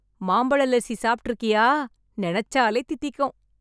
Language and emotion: Tamil, happy